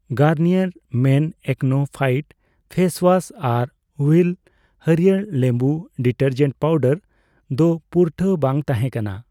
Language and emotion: Santali, neutral